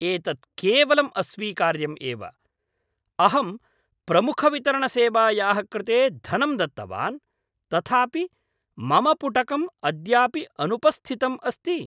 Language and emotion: Sanskrit, angry